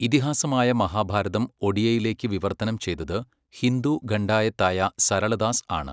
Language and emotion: Malayalam, neutral